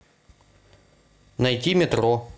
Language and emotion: Russian, neutral